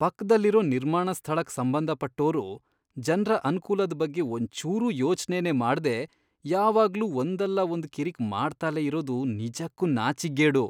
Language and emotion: Kannada, disgusted